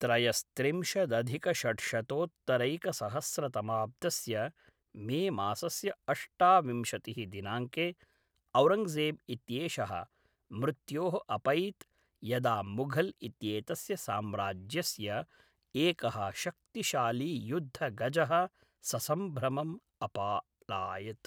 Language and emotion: Sanskrit, neutral